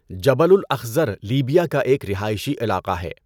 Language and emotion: Urdu, neutral